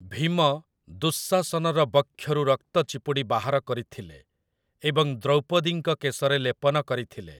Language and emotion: Odia, neutral